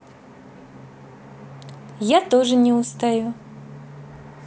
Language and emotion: Russian, positive